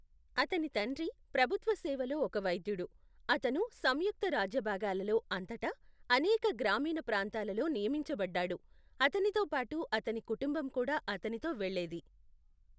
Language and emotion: Telugu, neutral